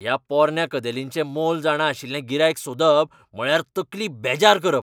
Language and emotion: Goan Konkani, angry